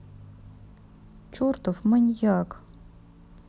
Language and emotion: Russian, sad